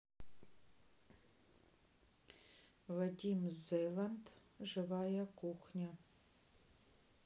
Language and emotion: Russian, neutral